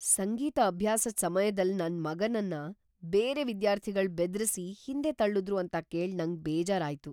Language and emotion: Kannada, surprised